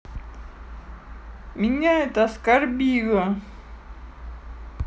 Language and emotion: Russian, sad